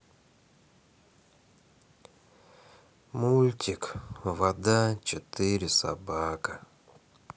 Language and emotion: Russian, sad